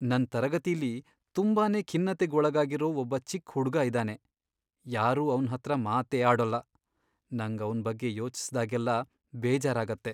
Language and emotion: Kannada, sad